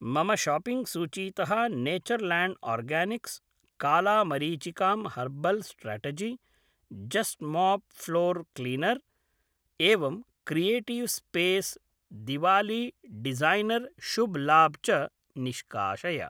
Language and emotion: Sanskrit, neutral